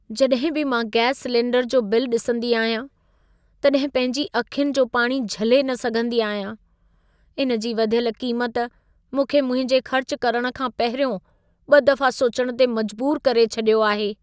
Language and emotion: Sindhi, sad